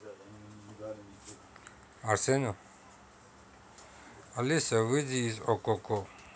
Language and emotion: Russian, neutral